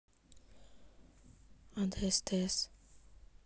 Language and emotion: Russian, neutral